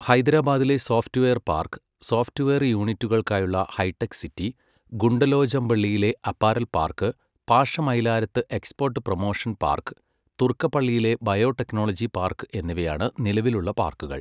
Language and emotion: Malayalam, neutral